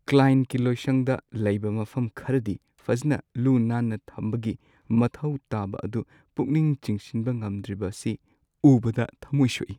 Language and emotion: Manipuri, sad